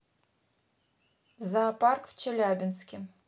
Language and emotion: Russian, neutral